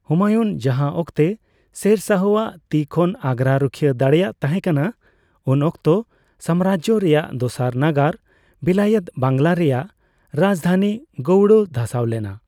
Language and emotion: Santali, neutral